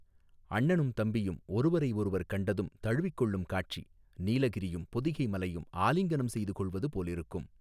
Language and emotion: Tamil, neutral